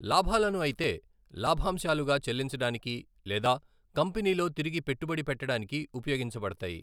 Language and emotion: Telugu, neutral